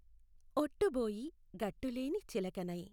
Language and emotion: Telugu, neutral